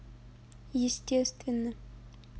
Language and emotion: Russian, neutral